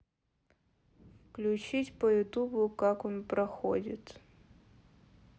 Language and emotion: Russian, neutral